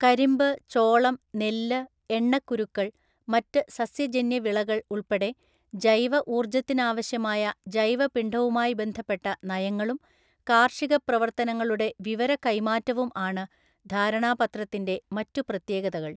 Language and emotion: Malayalam, neutral